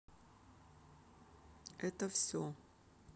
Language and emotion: Russian, neutral